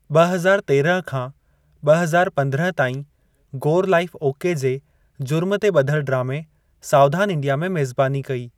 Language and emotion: Sindhi, neutral